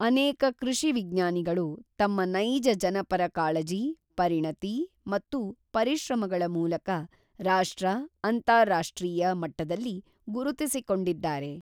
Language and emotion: Kannada, neutral